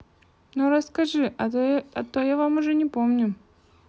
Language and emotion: Russian, neutral